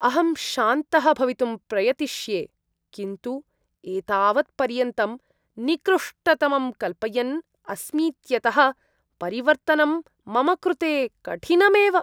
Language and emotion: Sanskrit, disgusted